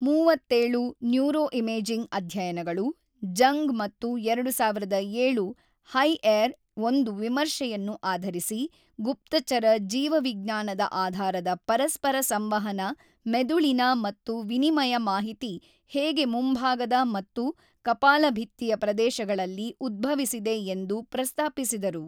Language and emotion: Kannada, neutral